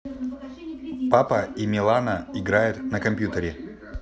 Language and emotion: Russian, neutral